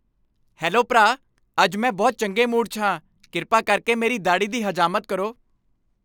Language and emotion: Punjabi, happy